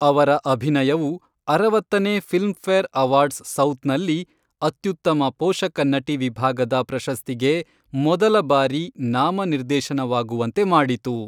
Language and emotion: Kannada, neutral